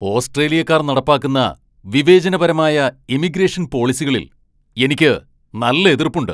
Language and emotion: Malayalam, angry